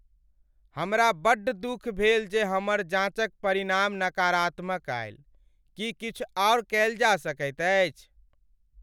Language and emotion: Maithili, sad